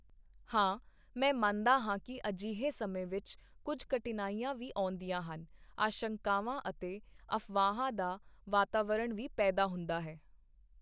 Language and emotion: Punjabi, neutral